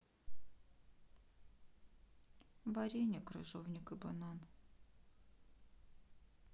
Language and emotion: Russian, sad